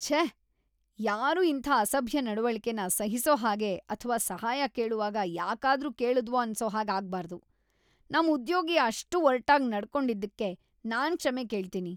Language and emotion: Kannada, disgusted